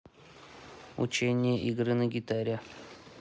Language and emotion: Russian, neutral